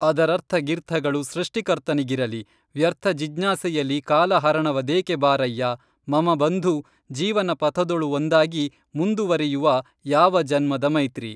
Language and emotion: Kannada, neutral